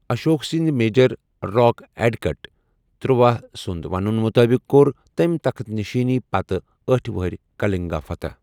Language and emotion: Kashmiri, neutral